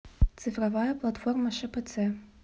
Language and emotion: Russian, neutral